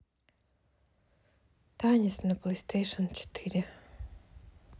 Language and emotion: Russian, sad